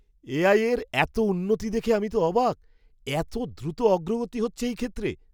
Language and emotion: Bengali, surprised